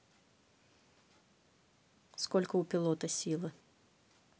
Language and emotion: Russian, neutral